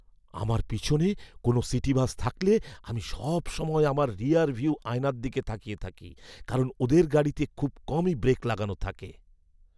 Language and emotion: Bengali, fearful